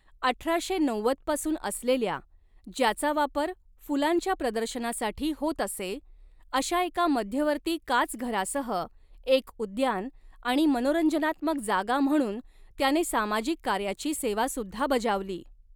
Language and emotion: Marathi, neutral